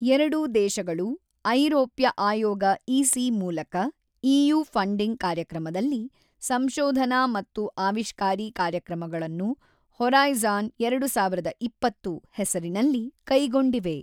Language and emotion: Kannada, neutral